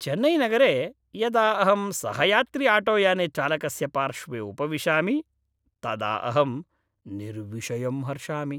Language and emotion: Sanskrit, happy